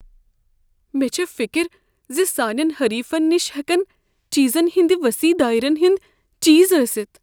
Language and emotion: Kashmiri, fearful